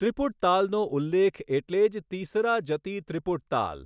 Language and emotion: Gujarati, neutral